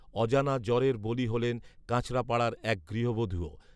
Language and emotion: Bengali, neutral